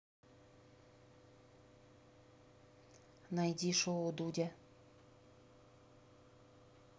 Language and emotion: Russian, neutral